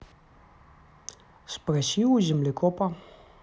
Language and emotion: Russian, neutral